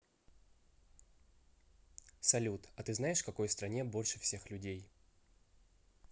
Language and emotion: Russian, neutral